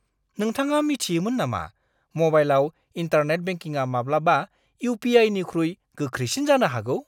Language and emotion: Bodo, surprised